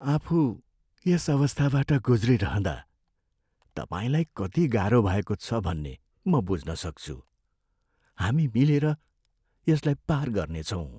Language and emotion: Nepali, sad